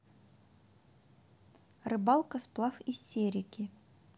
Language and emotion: Russian, neutral